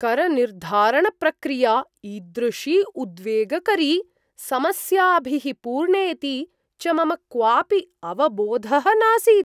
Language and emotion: Sanskrit, surprised